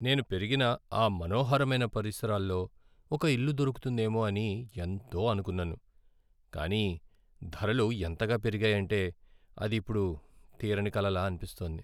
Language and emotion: Telugu, sad